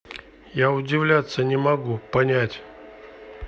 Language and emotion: Russian, neutral